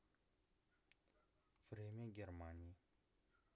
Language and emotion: Russian, neutral